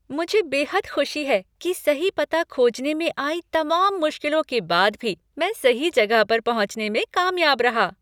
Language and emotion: Hindi, happy